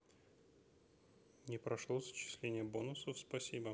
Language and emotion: Russian, neutral